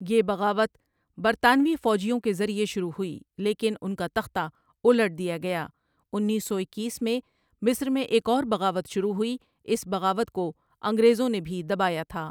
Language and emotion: Urdu, neutral